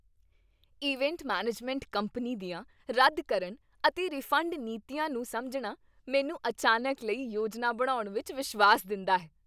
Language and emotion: Punjabi, happy